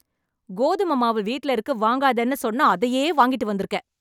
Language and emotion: Tamil, angry